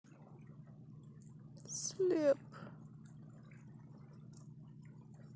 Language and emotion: Russian, neutral